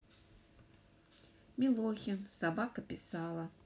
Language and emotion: Russian, neutral